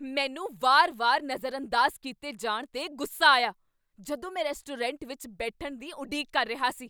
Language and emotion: Punjabi, angry